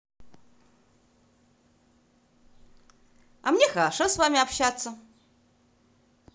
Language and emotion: Russian, positive